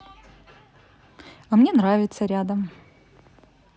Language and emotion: Russian, neutral